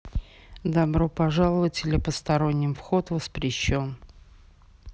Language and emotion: Russian, neutral